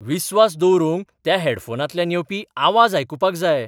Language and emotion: Goan Konkani, surprised